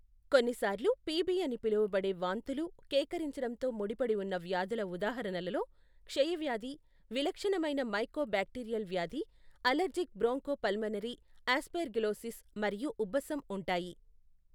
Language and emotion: Telugu, neutral